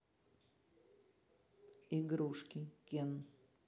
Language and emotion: Russian, neutral